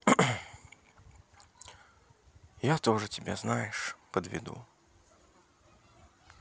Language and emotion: Russian, sad